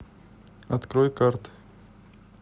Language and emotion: Russian, neutral